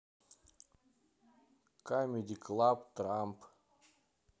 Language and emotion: Russian, neutral